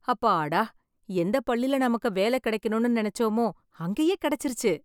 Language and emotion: Tamil, happy